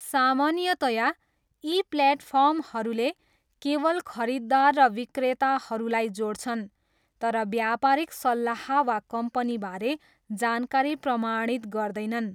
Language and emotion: Nepali, neutral